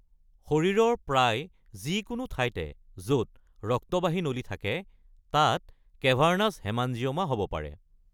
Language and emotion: Assamese, neutral